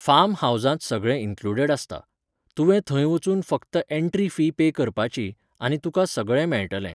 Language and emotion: Goan Konkani, neutral